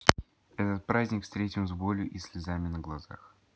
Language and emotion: Russian, neutral